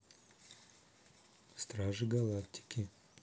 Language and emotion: Russian, neutral